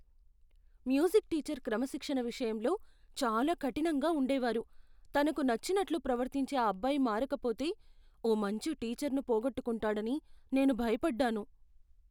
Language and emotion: Telugu, fearful